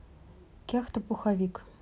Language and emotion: Russian, neutral